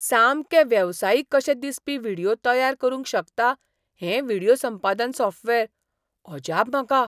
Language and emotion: Goan Konkani, surprised